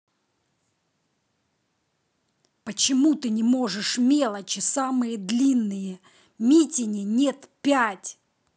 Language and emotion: Russian, angry